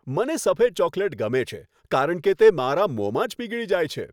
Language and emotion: Gujarati, happy